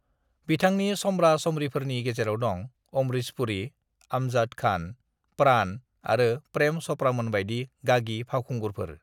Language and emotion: Bodo, neutral